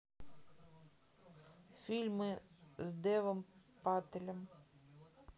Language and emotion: Russian, neutral